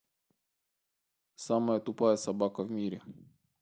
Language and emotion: Russian, neutral